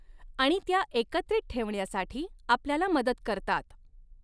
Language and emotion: Marathi, neutral